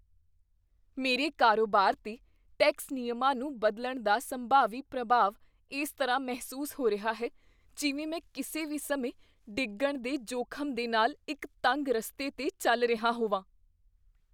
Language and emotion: Punjabi, fearful